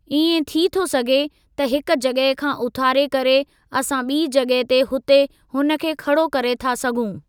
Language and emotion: Sindhi, neutral